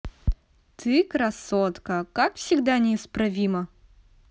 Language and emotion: Russian, positive